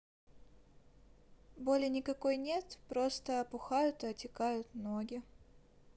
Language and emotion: Russian, neutral